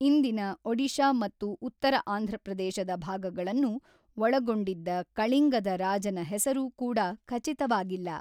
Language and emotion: Kannada, neutral